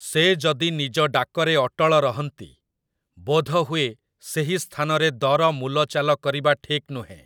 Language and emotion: Odia, neutral